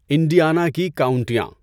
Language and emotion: Urdu, neutral